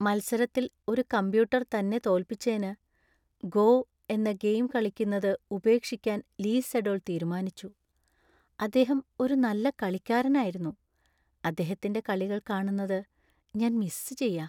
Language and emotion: Malayalam, sad